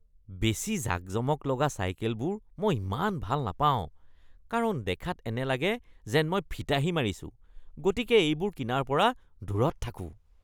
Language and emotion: Assamese, disgusted